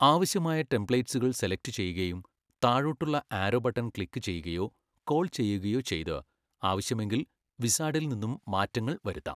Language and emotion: Malayalam, neutral